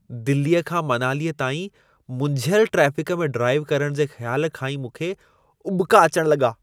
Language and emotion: Sindhi, disgusted